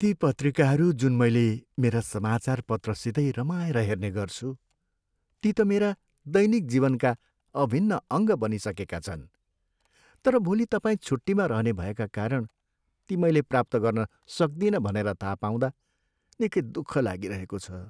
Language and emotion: Nepali, sad